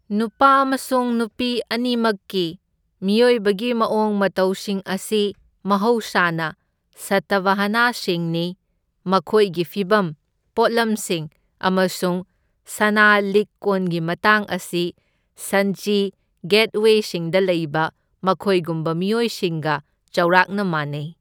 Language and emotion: Manipuri, neutral